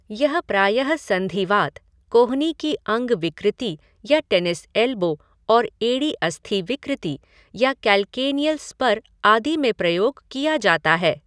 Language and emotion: Hindi, neutral